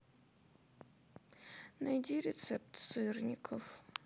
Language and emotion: Russian, sad